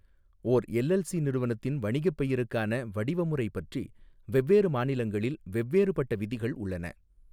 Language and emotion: Tamil, neutral